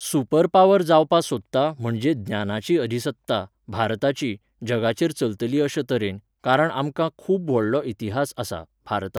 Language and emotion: Goan Konkani, neutral